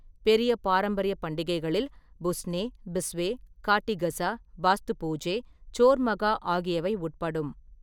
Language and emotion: Tamil, neutral